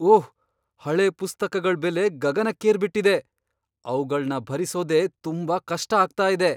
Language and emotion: Kannada, surprised